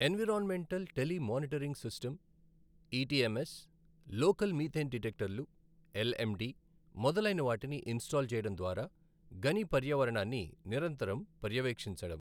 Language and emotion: Telugu, neutral